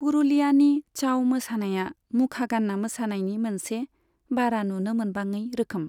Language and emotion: Bodo, neutral